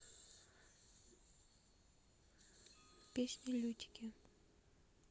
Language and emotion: Russian, neutral